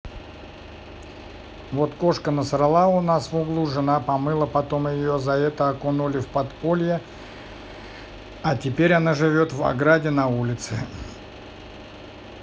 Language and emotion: Russian, neutral